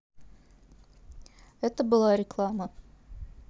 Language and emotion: Russian, neutral